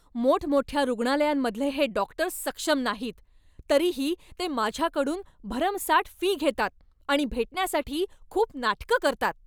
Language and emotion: Marathi, angry